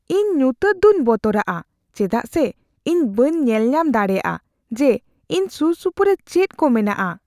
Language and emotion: Santali, fearful